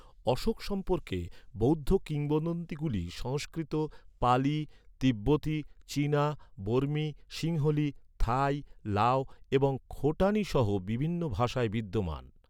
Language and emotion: Bengali, neutral